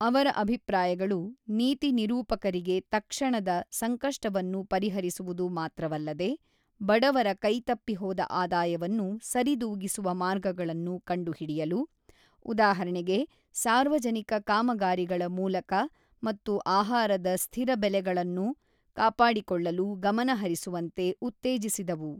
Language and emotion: Kannada, neutral